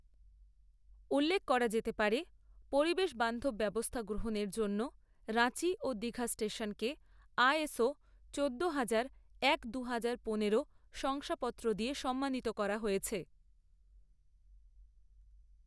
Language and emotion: Bengali, neutral